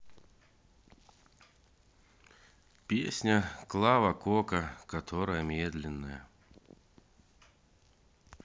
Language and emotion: Russian, sad